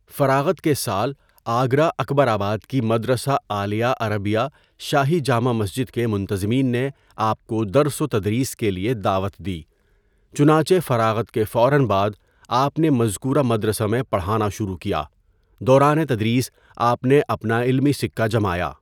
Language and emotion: Urdu, neutral